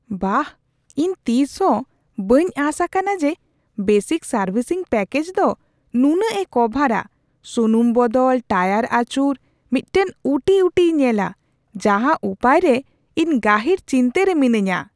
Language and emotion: Santali, surprised